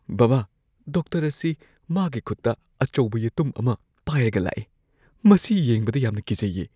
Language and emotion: Manipuri, fearful